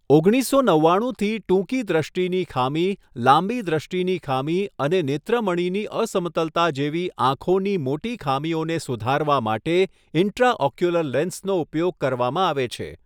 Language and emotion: Gujarati, neutral